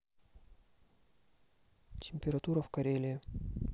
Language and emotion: Russian, neutral